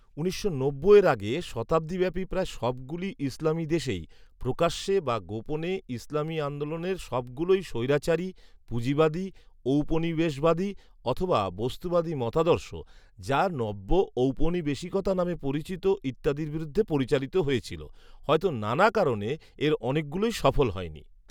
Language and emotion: Bengali, neutral